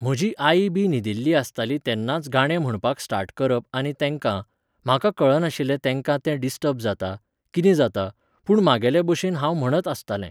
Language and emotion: Goan Konkani, neutral